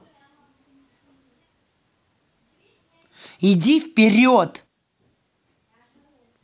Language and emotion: Russian, angry